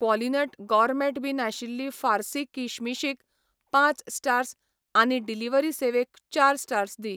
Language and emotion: Goan Konkani, neutral